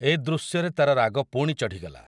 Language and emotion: Odia, neutral